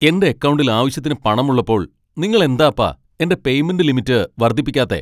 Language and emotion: Malayalam, angry